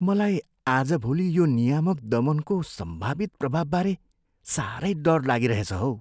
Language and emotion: Nepali, fearful